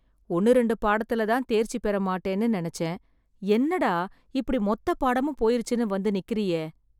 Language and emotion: Tamil, sad